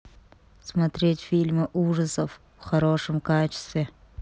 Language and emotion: Russian, neutral